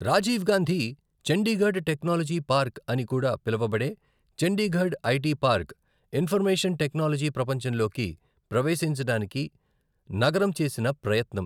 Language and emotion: Telugu, neutral